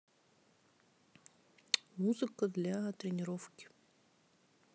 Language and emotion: Russian, neutral